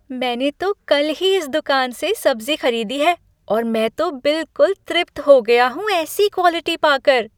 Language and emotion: Hindi, happy